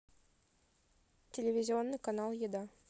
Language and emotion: Russian, neutral